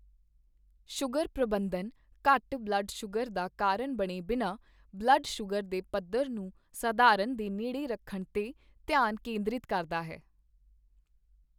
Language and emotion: Punjabi, neutral